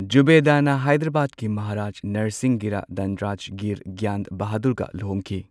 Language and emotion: Manipuri, neutral